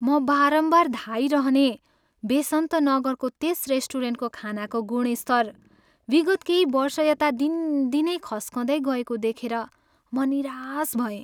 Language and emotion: Nepali, sad